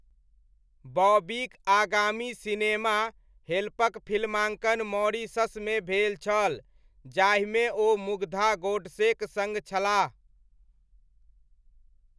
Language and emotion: Maithili, neutral